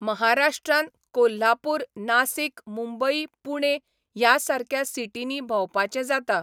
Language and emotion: Goan Konkani, neutral